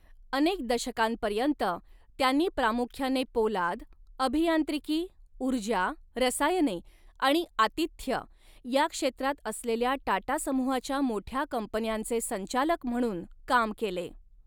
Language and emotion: Marathi, neutral